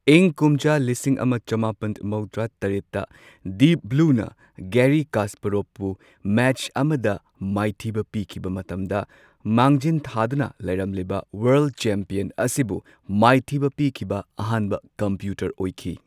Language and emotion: Manipuri, neutral